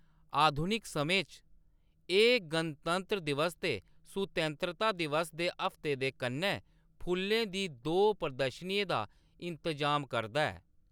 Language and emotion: Dogri, neutral